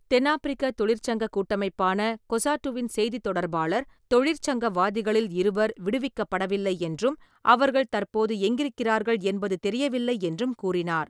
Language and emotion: Tamil, neutral